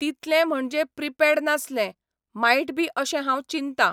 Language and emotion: Goan Konkani, neutral